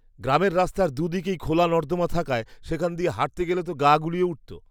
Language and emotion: Bengali, disgusted